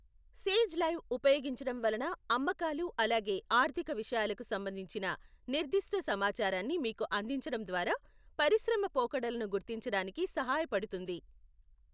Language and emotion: Telugu, neutral